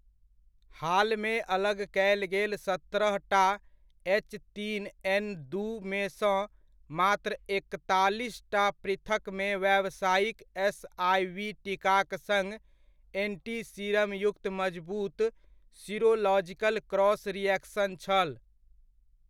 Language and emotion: Maithili, neutral